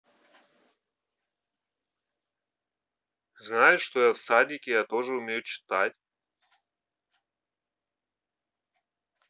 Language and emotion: Russian, neutral